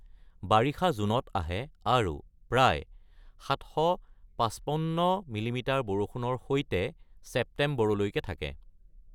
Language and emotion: Assamese, neutral